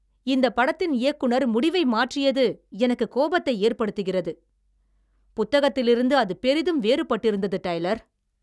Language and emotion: Tamil, angry